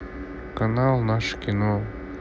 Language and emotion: Russian, neutral